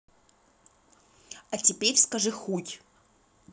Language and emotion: Russian, angry